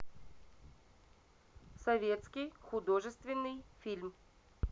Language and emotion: Russian, neutral